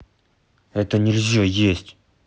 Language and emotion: Russian, angry